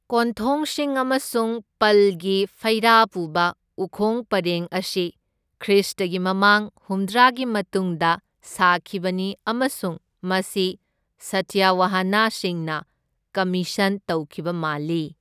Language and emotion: Manipuri, neutral